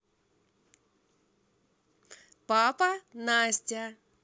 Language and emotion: Russian, positive